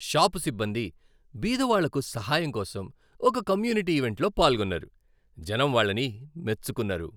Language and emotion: Telugu, happy